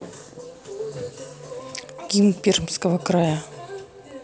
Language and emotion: Russian, neutral